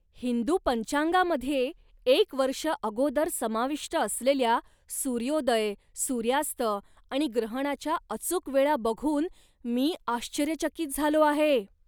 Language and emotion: Marathi, surprised